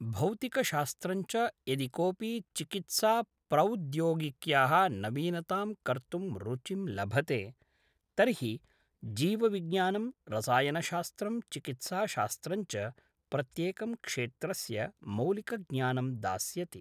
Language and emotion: Sanskrit, neutral